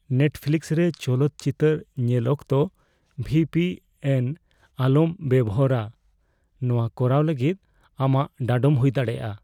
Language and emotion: Santali, fearful